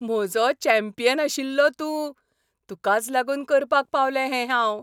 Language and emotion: Goan Konkani, happy